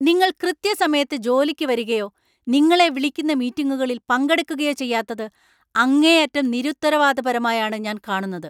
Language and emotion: Malayalam, angry